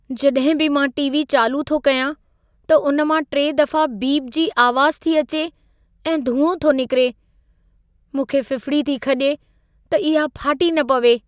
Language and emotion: Sindhi, fearful